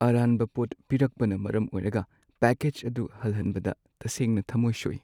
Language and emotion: Manipuri, sad